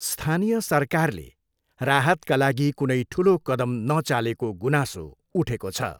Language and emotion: Nepali, neutral